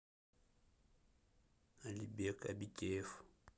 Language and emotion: Russian, neutral